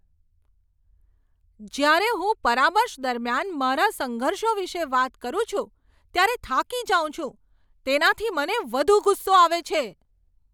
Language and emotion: Gujarati, angry